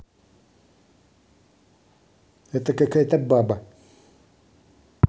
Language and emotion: Russian, angry